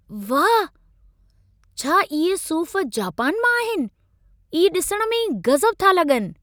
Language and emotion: Sindhi, surprised